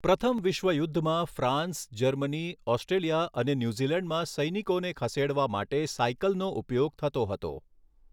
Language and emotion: Gujarati, neutral